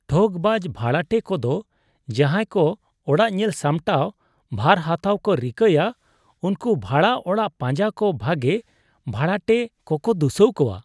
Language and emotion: Santali, disgusted